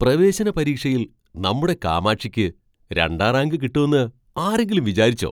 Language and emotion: Malayalam, surprised